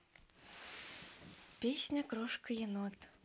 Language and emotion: Russian, neutral